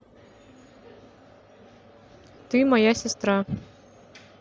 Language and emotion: Russian, neutral